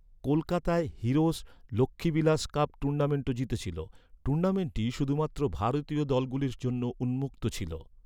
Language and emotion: Bengali, neutral